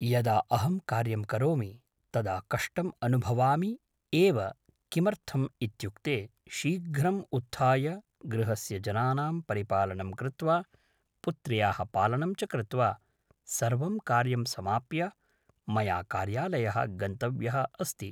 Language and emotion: Sanskrit, neutral